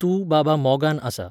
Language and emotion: Goan Konkani, neutral